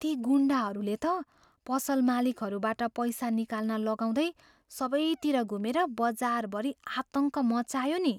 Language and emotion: Nepali, fearful